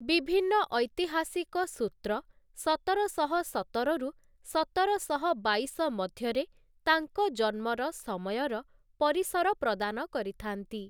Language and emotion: Odia, neutral